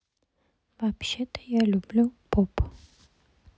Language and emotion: Russian, neutral